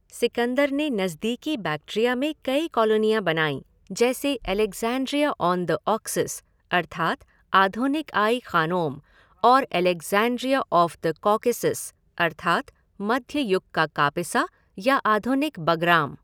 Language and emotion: Hindi, neutral